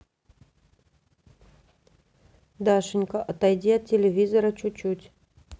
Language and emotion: Russian, neutral